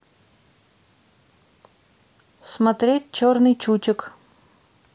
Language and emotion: Russian, neutral